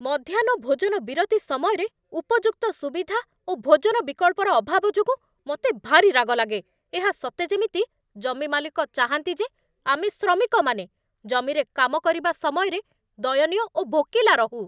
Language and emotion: Odia, angry